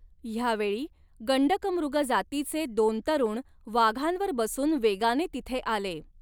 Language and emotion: Marathi, neutral